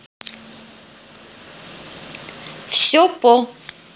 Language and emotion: Russian, neutral